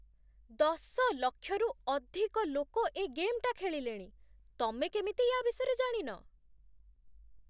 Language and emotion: Odia, surprised